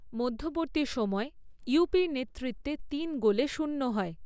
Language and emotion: Bengali, neutral